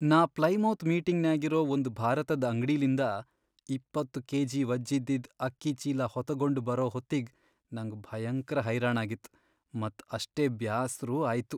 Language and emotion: Kannada, sad